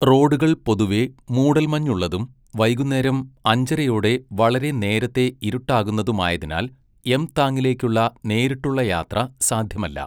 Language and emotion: Malayalam, neutral